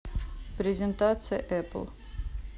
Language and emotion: Russian, neutral